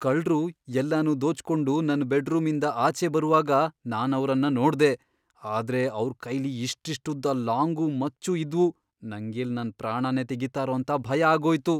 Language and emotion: Kannada, fearful